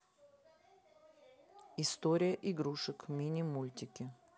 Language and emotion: Russian, neutral